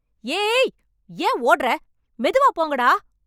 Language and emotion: Tamil, angry